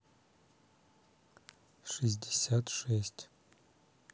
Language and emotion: Russian, neutral